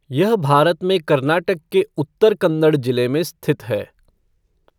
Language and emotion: Hindi, neutral